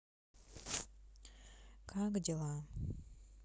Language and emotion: Russian, sad